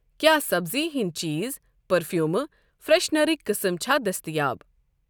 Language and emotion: Kashmiri, neutral